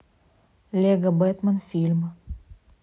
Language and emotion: Russian, neutral